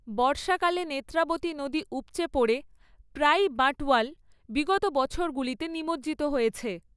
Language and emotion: Bengali, neutral